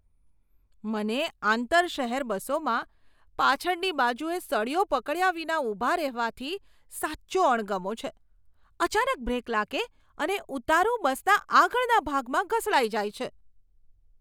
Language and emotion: Gujarati, disgusted